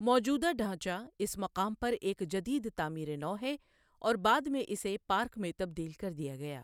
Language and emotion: Urdu, neutral